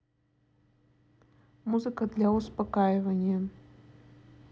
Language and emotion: Russian, neutral